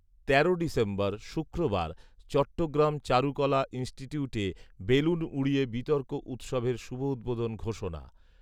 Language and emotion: Bengali, neutral